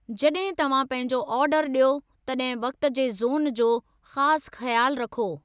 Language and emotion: Sindhi, neutral